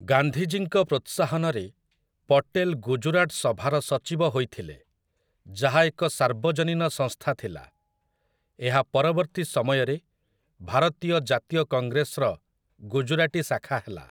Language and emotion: Odia, neutral